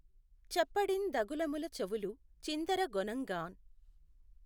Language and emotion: Telugu, neutral